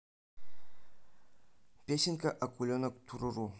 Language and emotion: Russian, neutral